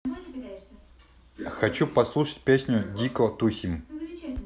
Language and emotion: Russian, neutral